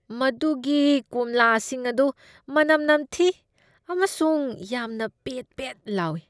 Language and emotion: Manipuri, disgusted